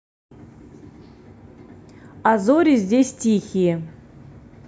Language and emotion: Russian, neutral